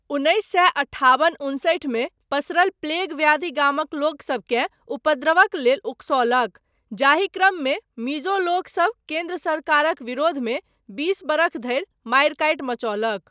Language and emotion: Maithili, neutral